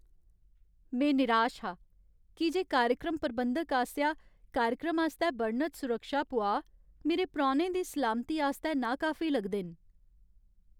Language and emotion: Dogri, sad